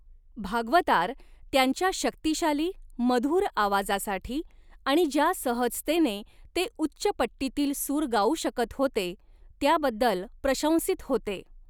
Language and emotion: Marathi, neutral